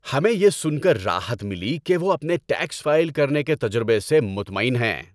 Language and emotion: Urdu, happy